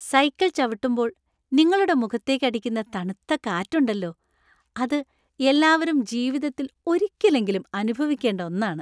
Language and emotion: Malayalam, happy